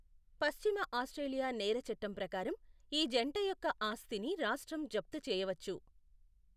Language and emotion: Telugu, neutral